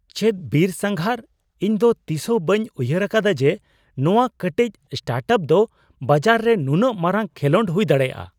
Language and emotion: Santali, surprised